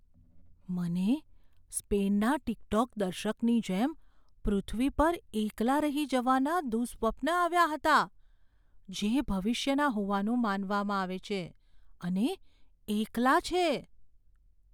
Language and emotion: Gujarati, fearful